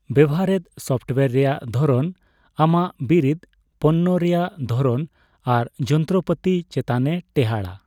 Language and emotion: Santali, neutral